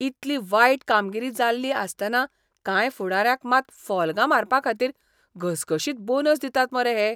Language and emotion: Goan Konkani, disgusted